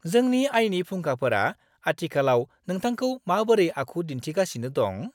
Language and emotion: Bodo, happy